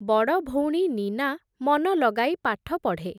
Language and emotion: Odia, neutral